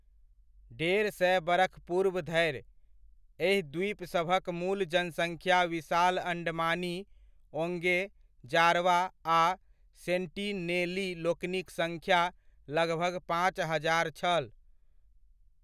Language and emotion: Maithili, neutral